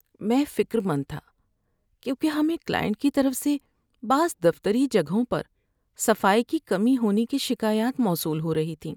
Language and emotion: Urdu, sad